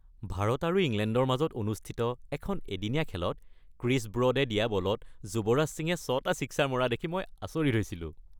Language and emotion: Assamese, happy